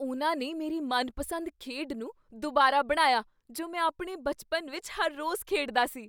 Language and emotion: Punjabi, surprised